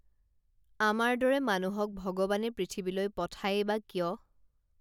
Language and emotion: Assamese, neutral